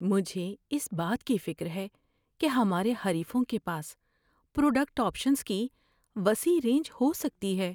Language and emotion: Urdu, fearful